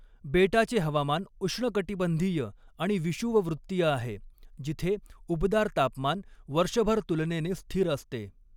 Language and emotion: Marathi, neutral